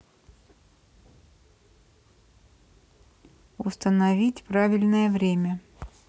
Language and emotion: Russian, neutral